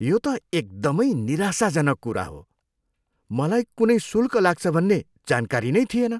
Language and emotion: Nepali, disgusted